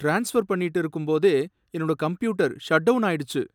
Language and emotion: Tamil, sad